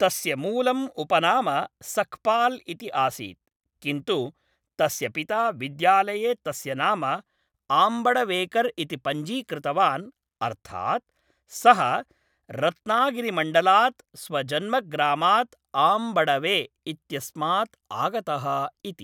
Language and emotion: Sanskrit, neutral